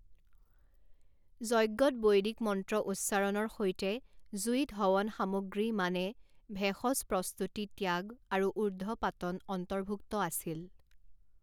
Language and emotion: Assamese, neutral